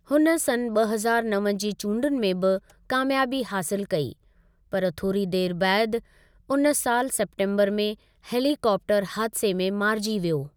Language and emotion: Sindhi, neutral